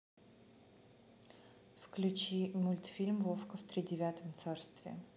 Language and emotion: Russian, neutral